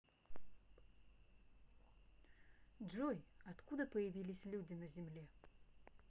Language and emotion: Russian, neutral